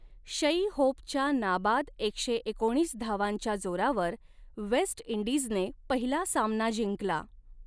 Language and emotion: Marathi, neutral